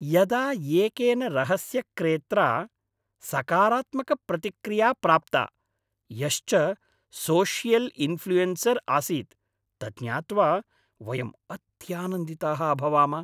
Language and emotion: Sanskrit, happy